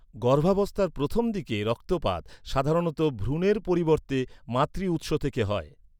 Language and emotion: Bengali, neutral